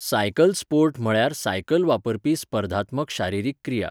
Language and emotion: Goan Konkani, neutral